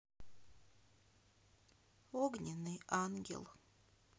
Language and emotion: Russian, sad